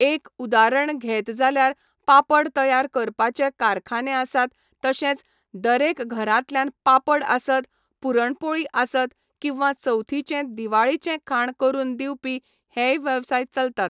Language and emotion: Goan Konkani, neutral